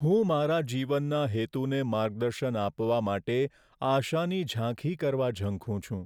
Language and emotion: Gujarati, sad